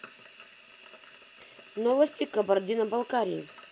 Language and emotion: Russian, neutral